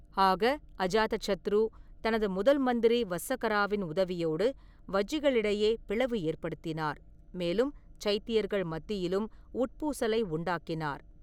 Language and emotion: Tamil, neutral